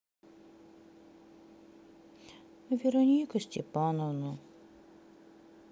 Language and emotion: Russian, sad